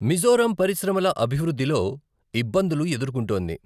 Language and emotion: Telugu, neutral